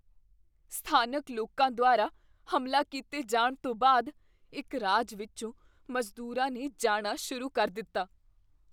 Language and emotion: Punjabi, fearful